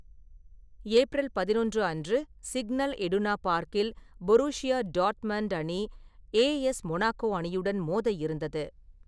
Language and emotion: Tamil, neutral